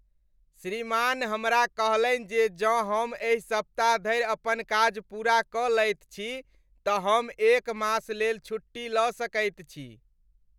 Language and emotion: Maithili, happy